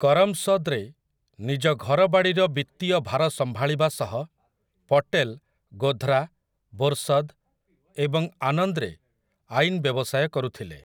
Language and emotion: Odia, neutral